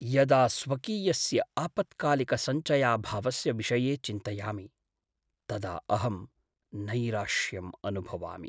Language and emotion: Sanskrit, sad